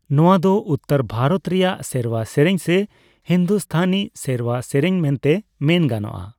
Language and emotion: Santali, neutral